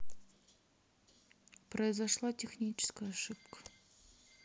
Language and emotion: Russian, sad